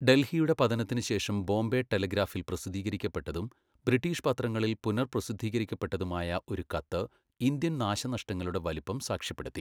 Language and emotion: Malayalam, neutral